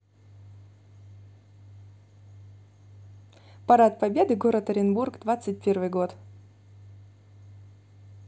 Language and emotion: Russian, neutral